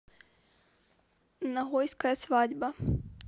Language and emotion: Russian, neutral